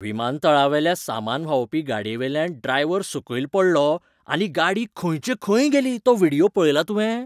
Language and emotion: Goan Konkani, surprised